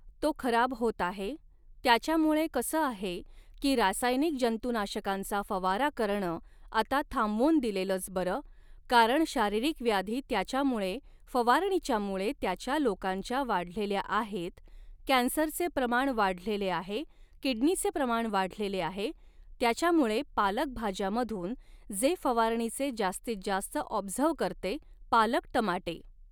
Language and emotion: Marathi, neutral